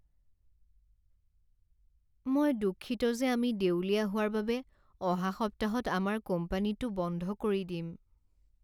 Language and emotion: Assamese, sad